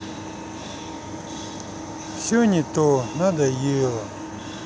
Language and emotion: Russian, sad